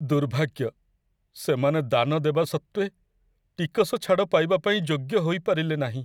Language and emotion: Odia, sad